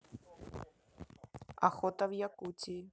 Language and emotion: Russian, neutral